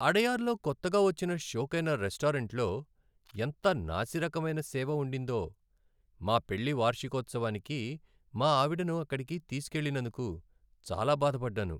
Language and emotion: Telugu, sad